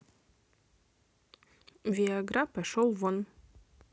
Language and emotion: Russian, neutral